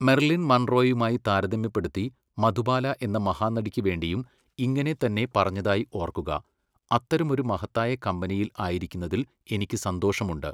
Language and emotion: Malayalam, neutral